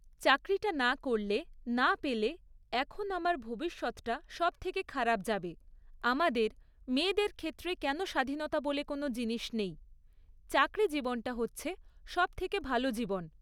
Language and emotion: Bengali, neutral